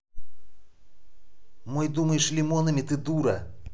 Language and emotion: Russian, angry